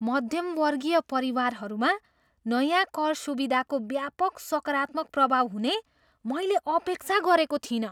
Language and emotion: Nepali, surprised